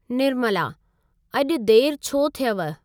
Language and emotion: Sindhi, neutral